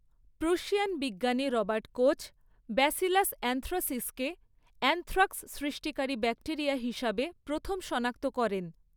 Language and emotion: Bengali, neutral